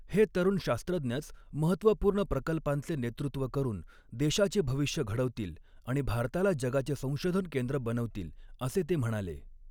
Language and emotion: Marathi, neutral